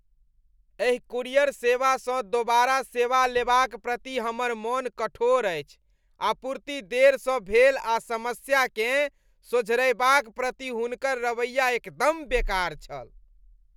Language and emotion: Maithili, disgusted